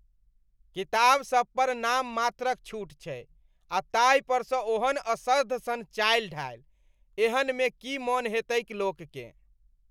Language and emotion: Maithili, disgusted